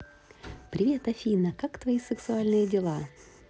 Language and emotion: Russian, positive